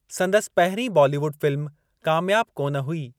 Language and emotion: Sindhi, neutral